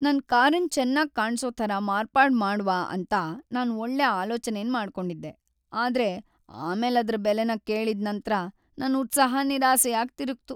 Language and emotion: Kannada, sad